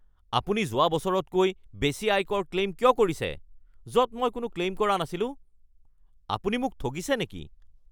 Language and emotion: Assamese, angry